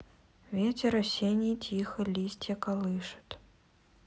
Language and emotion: Russian, sad